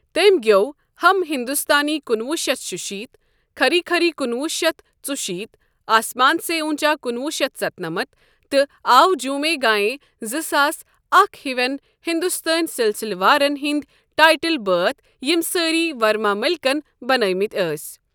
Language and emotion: Kashmiri, neutral